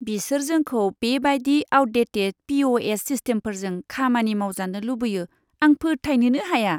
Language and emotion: Bodo, disgusted